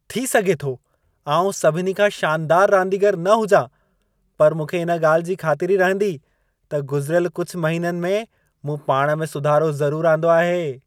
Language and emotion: Sindhi, happy